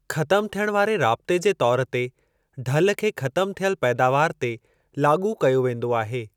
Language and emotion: Sindhi, neutral